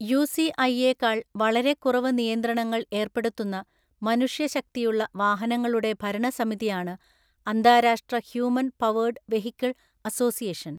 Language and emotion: Malayalam, neutral